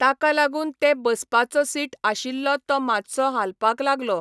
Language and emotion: Goan Konkani, neutral